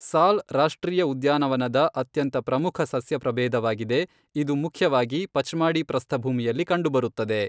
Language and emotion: Kannada, neutral